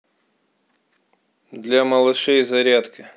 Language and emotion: Russian, neutral